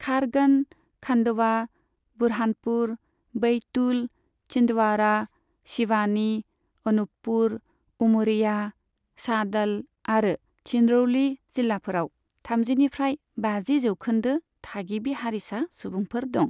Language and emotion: Bodo, neutral